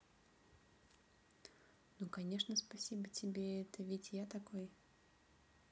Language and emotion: Russian, neutral